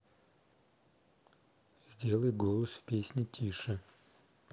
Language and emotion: Russian, neutral